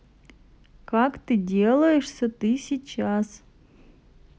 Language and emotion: Russian, neutral